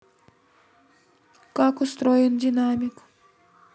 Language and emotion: Russian, neutral